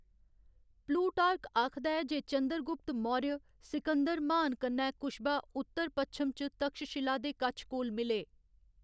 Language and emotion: Dogri, neutral